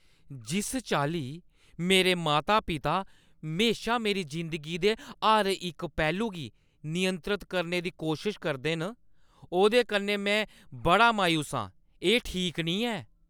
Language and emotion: Dogri, angry